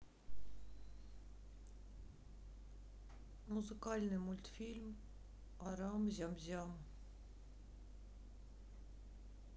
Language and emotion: Russian, sad